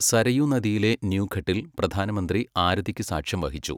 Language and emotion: Malayalam, neutral